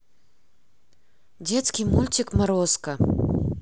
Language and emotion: Russian, neutral